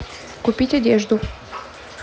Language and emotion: Russian, neutral